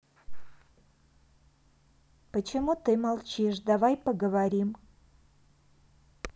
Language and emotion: Russian, neutral